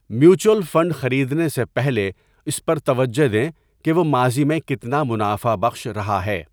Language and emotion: Urdu, neutral